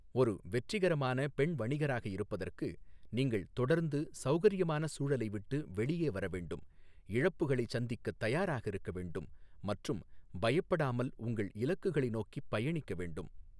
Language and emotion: Tamil, neutral